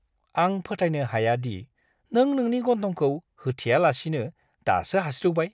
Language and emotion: Bodo, disgusted